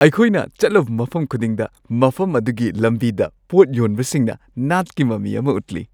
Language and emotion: Manipuri, happy